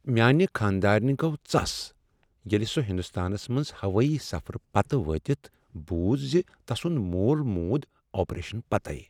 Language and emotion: Kashmiri, sad